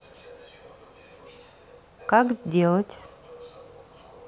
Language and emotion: Russian, neutral